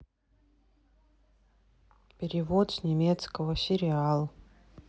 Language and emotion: Russian, neutral